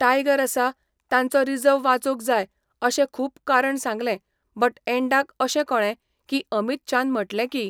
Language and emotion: Goan Konkani, neutral